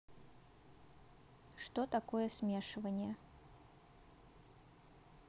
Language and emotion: Russian, neutral